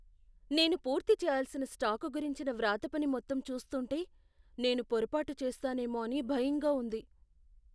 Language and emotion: Telugu, fearful